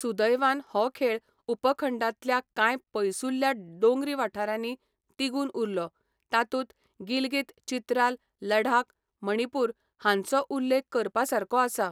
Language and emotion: Goan Konkani, neutral